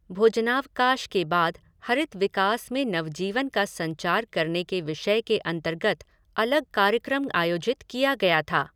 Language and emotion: Hindi, neutral